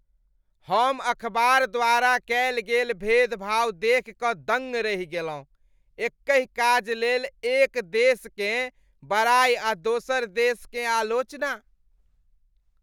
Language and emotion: Maithili, disgusted